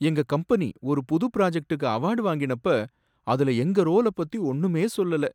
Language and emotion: Tamil, sad